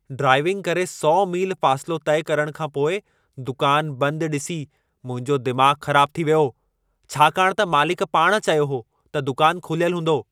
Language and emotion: Sindhi, angry